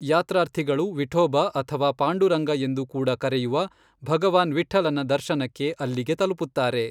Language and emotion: Kannada, neutral